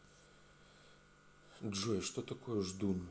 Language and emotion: Russian, neutral